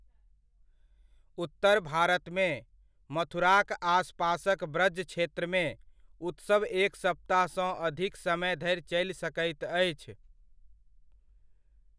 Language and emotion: Maithili, neutral